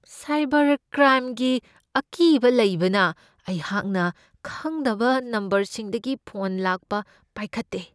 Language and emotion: Manipuri, fearful